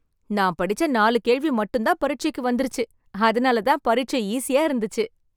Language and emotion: Tamil, happy